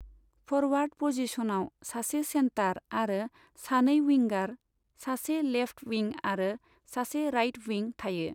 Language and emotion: Bodo, neutral